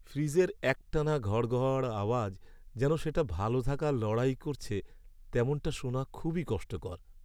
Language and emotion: Bengali, sad